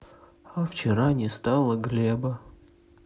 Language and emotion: Russian, sad